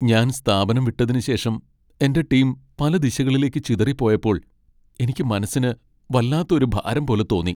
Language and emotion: Malayalam, sad